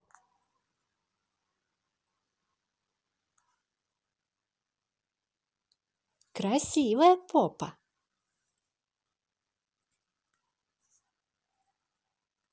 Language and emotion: Russian, positive